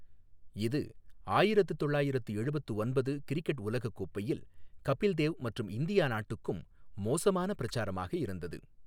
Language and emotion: Tamil, neutral